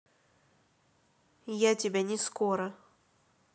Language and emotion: Russian, neutral